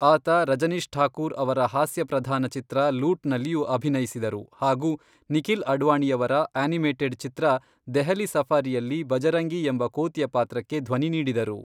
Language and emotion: Kannada, neutral